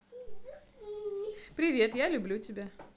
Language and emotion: Russian, positive